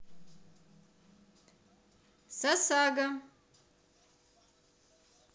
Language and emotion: Russian, positive